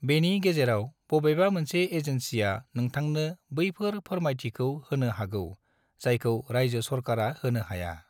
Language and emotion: Bodo, neutral